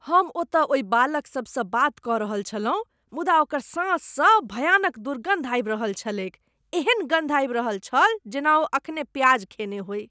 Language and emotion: Maithili, disgusted